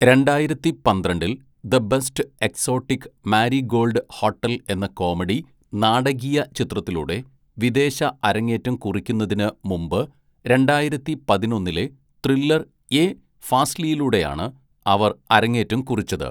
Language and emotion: Malayalam, neutral